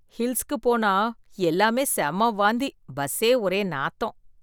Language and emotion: Tamil, disgusted